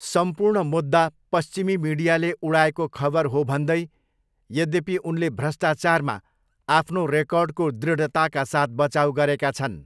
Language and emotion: Nepali, neutral